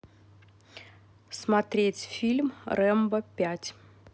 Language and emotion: Russian, neutral